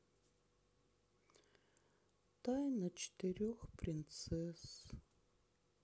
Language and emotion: Russian, sad